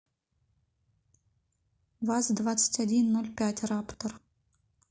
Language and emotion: Russian, neutral